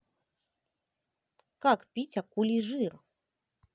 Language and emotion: Russian, neutral